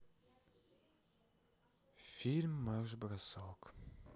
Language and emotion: Russian, sad